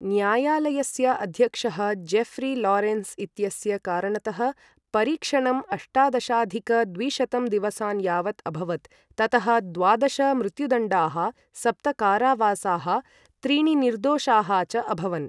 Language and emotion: Sanskrit, neutral